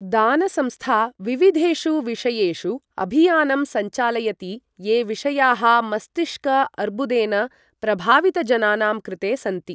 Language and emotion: Sanskrit, neutral